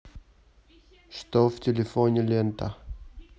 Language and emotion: Russian, neutral